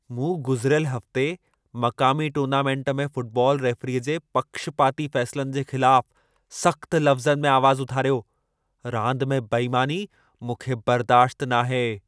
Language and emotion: Sindhi, angry